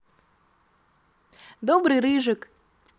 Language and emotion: Russian, positive